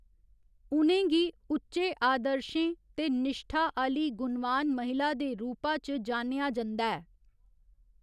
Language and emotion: Dogri, neutral